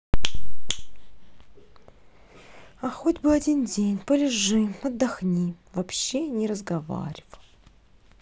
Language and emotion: Russian, neutral